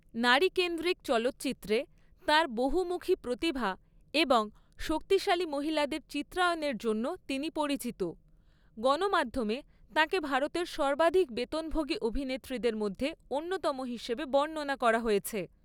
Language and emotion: Bengali, neutral